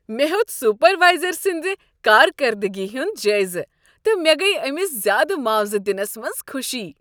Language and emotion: Kashmiri, happy